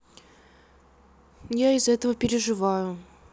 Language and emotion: Russian, sad